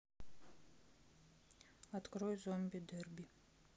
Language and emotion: Russian, neutral